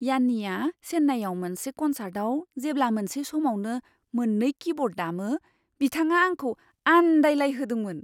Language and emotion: Bodo, surprised